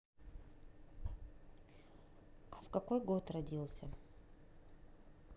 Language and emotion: Russian, neutral